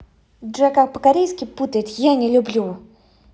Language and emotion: Russian, angry